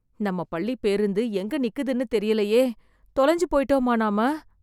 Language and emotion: Tamil, fearful